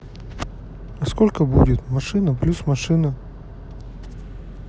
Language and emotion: Russian, neutral